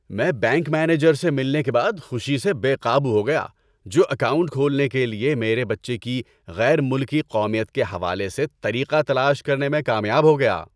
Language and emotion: Urdu, happy